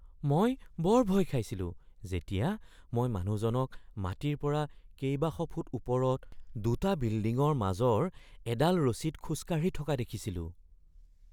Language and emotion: Assamese, fearful